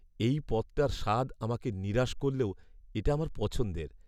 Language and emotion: Bengali, sad